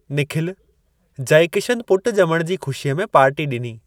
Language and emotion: Sindhi, neutral